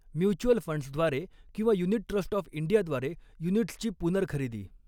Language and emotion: Marathi, neutral